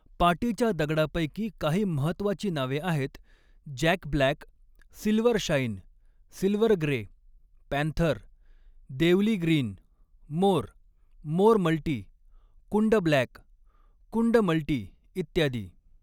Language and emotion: Marathi, neutral